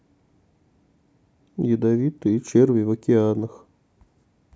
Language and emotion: Russian, neutral